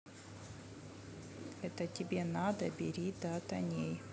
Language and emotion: Russian, neutral